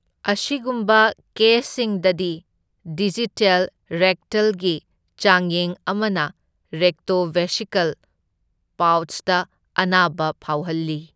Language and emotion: Manipuri, neutral